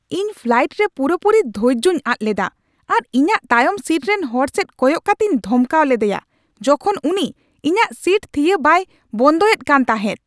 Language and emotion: Santali, angry